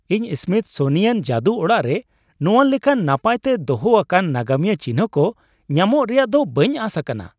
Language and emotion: Santali, surprised